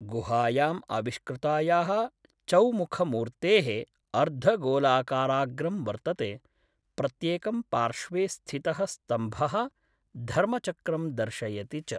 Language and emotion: Sanskrit, neutral